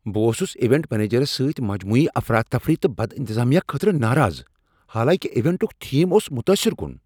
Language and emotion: Kashmiri, angry